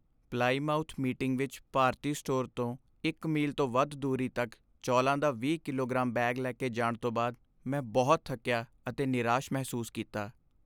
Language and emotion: Punjabi, sad